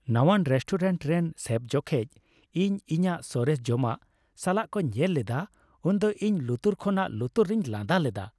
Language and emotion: Santali, happy